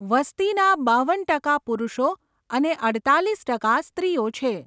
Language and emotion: Gujarati, neutral